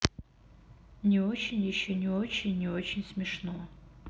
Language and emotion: Russian, sad